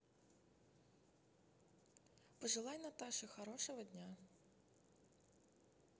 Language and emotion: Russian, neutral